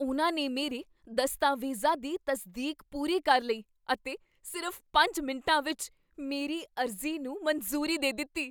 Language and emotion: Punjabi, surprised